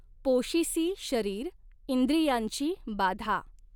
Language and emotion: Marathi, neutral